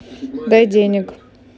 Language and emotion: Russian, neutral